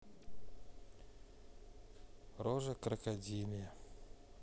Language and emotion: Russian, sad